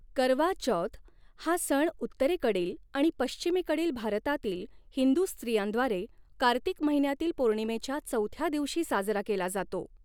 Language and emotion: Marathi, neutral